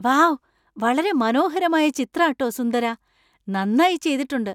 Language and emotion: Malayalam, surprised